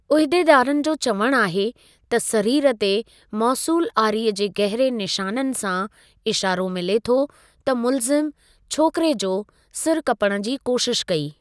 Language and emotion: Sindhi, neutral